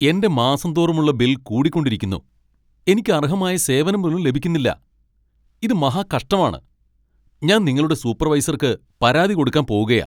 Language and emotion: Malayalam, angry